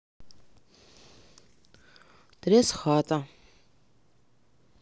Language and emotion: Russian, neutral